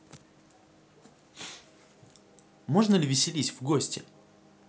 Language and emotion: Russian, neutral